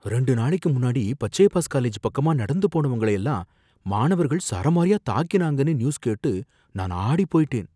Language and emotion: Tamil, fearful